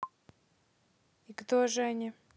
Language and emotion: Russian, neutral